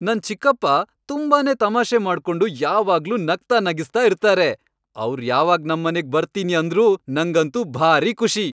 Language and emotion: Kannada, happy